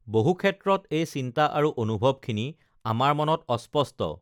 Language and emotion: Assamese, neutral